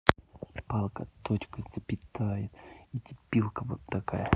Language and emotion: Russian, angry